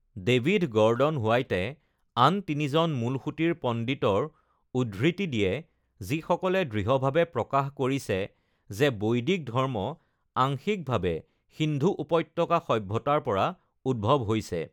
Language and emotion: Assamese, neutral